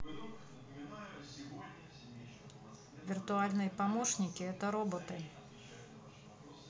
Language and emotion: Russian, neutral